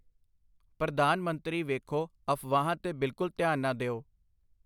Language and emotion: Punjabi, neutral